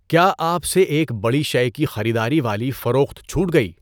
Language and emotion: Urdu, neutral